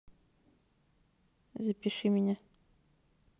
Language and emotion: Russian, neutral